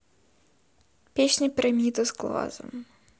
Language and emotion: Russian, sad